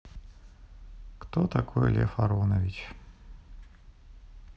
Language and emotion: Russian, neutral